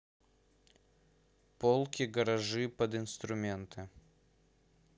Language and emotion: Russian, neutral